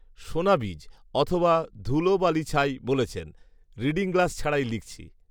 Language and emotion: Bengali, neutral